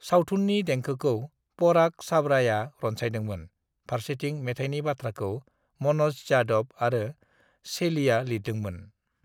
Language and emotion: Bodo, neutral